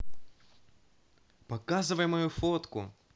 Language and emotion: Russian, positive